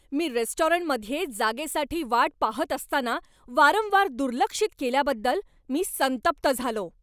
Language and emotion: Marathi, angry